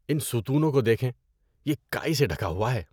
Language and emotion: Urdu, disgusted